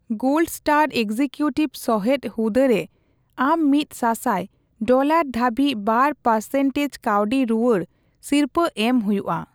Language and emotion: Santali, neutral